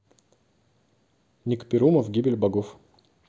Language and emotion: Russian, neutral